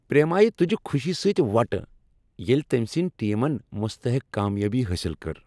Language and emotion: Kashmiri, happy